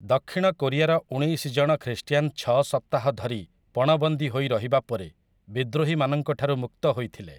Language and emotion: Odia, neutral